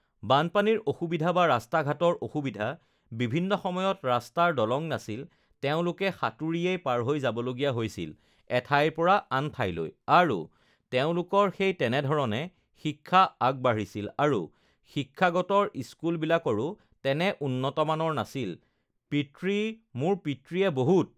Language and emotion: Assamese, neutral